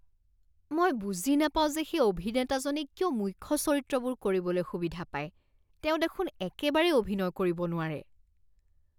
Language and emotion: Assamese, disgusted